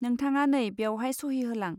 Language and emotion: Bodo, neutral